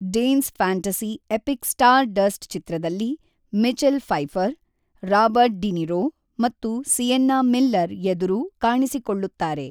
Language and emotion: Kannada, neutral